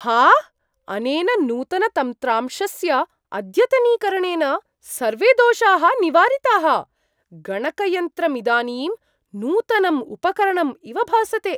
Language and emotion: Sanskrit, surprised